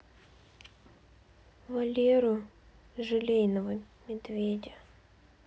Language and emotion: Russian, sad